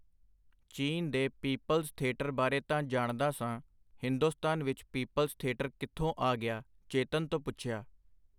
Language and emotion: Punjabi, neutral